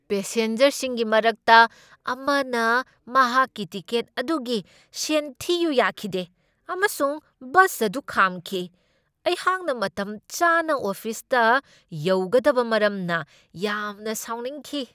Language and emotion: Manipuri, angry